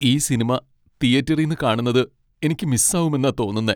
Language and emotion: Malayalam, sad